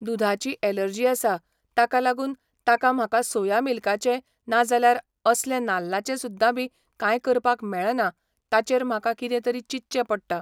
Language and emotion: Goan Konkani, neutral